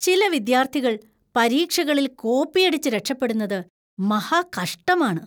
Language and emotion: Malayalam, disgusted